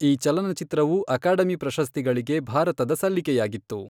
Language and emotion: Kannada, neutral